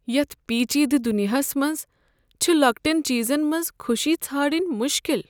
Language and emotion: Kashmiri, sad